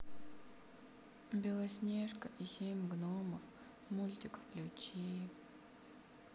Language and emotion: Russian, sad